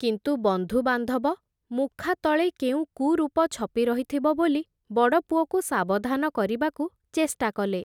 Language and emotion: Odia, neutral